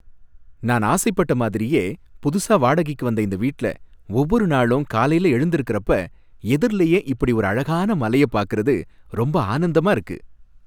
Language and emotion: Tamil, happy